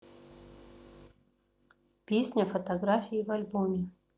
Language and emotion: Russian, neutral